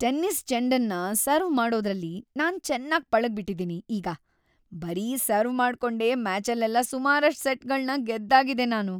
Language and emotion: Kannada, happy